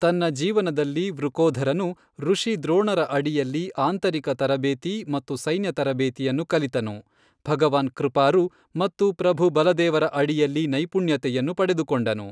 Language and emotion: Kannada, neutral